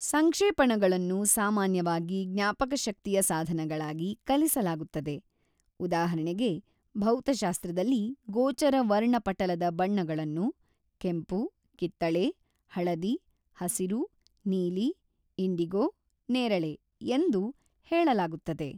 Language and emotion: Kannada, neutral